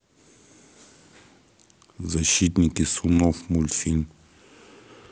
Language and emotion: Russian, neutral